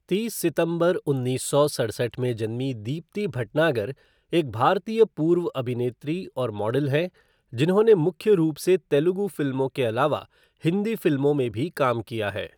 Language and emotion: Hindi, neutral